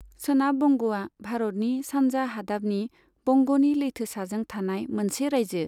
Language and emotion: Bodo, neutral